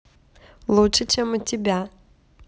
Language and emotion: Russian, positive